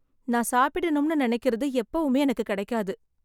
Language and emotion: Tamil, sad